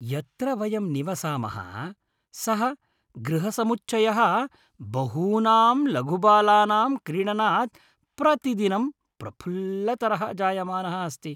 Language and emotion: Sanskrit, happy